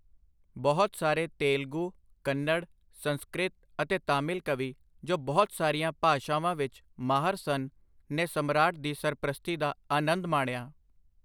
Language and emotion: Punjabi, neutral